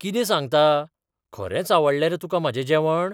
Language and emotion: Goan Konkani, surprised